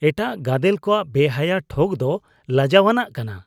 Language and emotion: Santali, disgusted